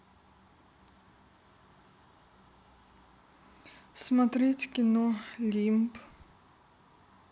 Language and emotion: Russian, sad